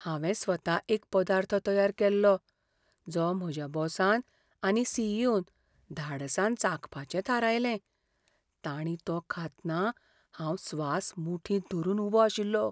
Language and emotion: Goan Konkani, fearful